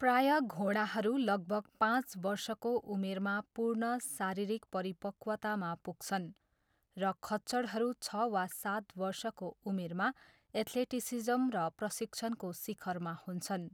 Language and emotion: Nepali, neutral